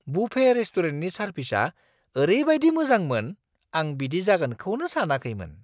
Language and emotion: Bodo, surprised